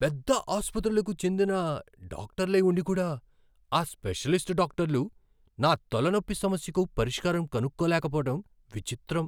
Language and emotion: Telugu, surprised